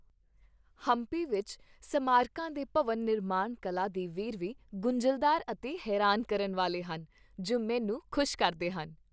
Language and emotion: Punjabi, happy